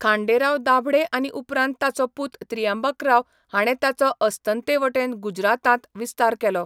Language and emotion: Goan Konkani, neutral